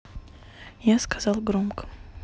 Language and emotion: Russian, neutral